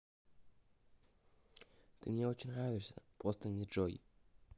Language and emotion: Russian, neutral